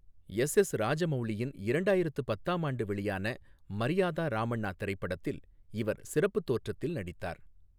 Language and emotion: Tamil, neutral